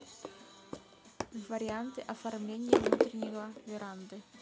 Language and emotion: Russian, neutral